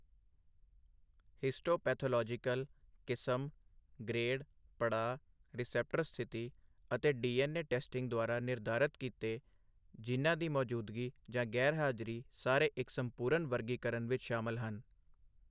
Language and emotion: Punjabi, neutral